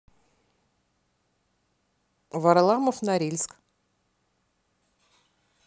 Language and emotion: Russian, neutral